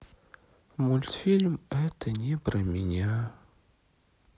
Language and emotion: Russian, sad